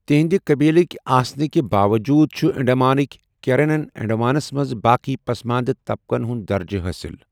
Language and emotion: Kashmiri, neutral